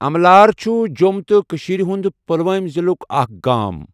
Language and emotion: Kashmiri, neutral